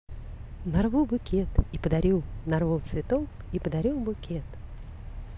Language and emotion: Russian, positive